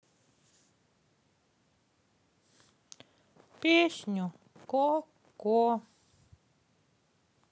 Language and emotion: Russian, sad